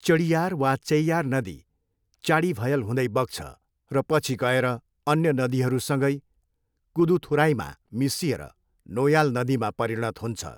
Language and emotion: Nepali, neutral